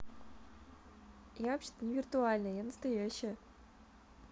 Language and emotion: Russian, neutral